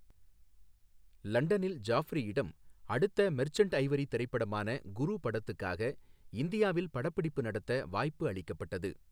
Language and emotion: Tamil, neutral